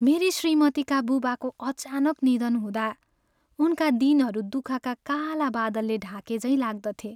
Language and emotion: Nepali, sad